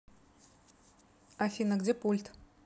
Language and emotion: Russian, neutral